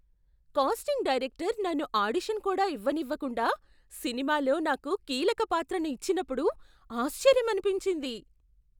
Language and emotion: Telugu, surprised